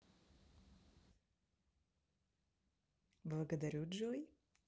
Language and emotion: Russian, positive